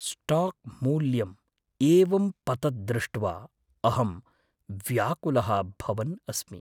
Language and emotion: Sanskrit, fearful